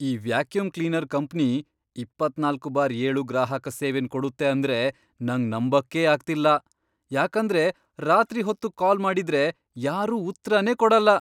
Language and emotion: Kannada, surprised